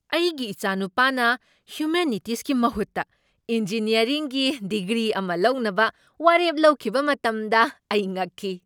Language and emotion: Manipuri, surprised